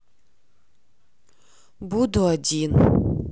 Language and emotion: Russian, sad